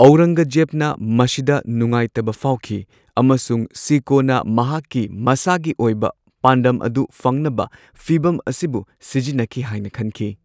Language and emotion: Manipuri, neutral